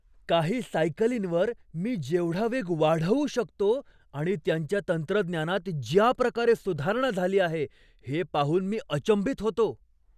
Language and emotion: Marathi, surprised